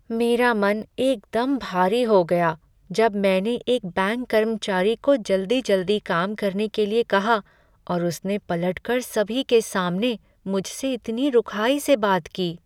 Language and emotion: Hindi, sad